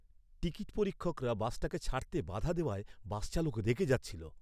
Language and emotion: Bengali, angry